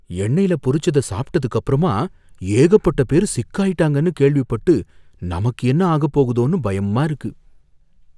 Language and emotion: Tamil, fearful